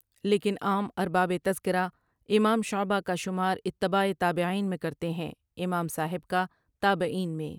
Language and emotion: Urdu, neutral